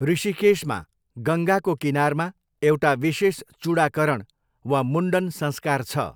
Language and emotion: Nepali, neutral